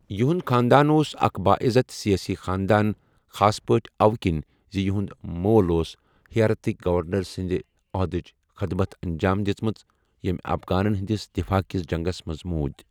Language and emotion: Kashmiri, neutral